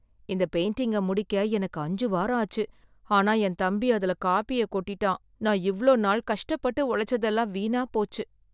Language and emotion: Tamil, sad